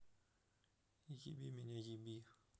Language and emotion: Russian, neutral